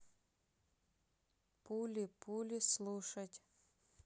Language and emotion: Russian, neutral